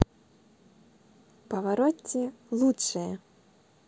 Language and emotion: Russian, neutral